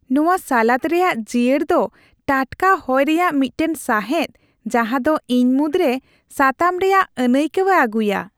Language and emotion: Santali, happy